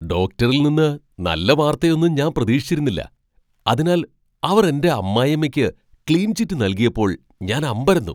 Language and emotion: Malayalam, surprised